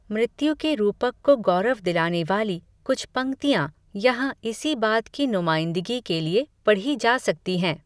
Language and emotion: Hindi, neutral